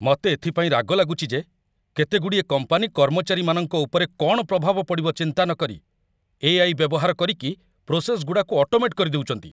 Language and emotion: Odia, angry